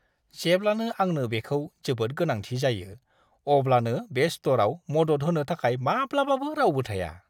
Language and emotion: Bodo, disgusted